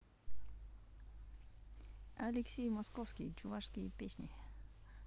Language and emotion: Russian, neutral